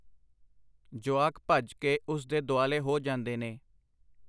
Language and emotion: Punjabi, neutral